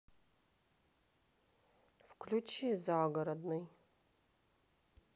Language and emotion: Russian, neutral